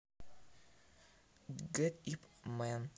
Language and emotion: Russian, neutral